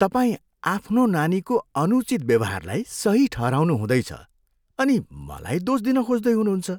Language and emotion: Nepali, disgusted